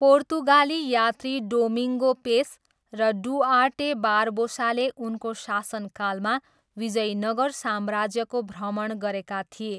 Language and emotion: Nepali, neutral